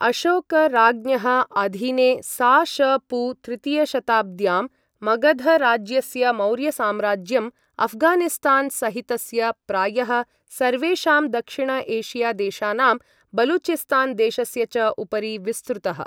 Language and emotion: Sanskrit, neutral